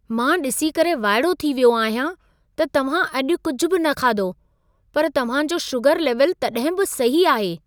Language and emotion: Sindhi, surprised